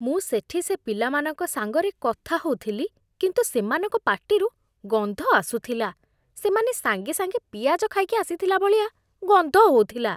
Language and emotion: Odia, disgusted